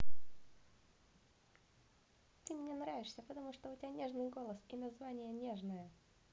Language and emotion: Russian, positive